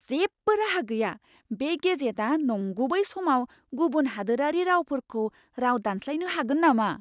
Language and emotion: Bodo, surprised